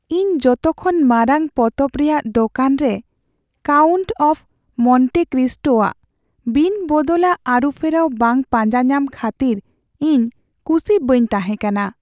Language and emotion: Santali, sad